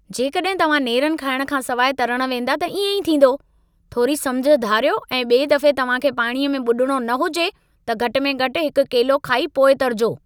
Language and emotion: Sindhi, angry